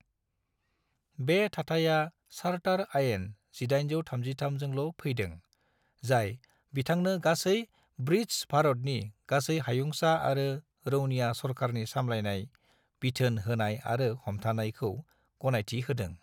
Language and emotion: Bodo, neutral